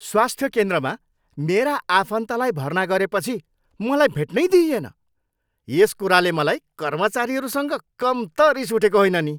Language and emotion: Nepali, angry